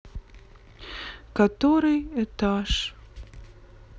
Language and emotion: Russian, sad